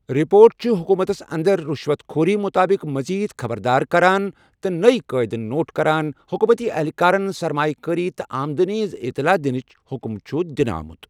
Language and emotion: Kashmiri, neutral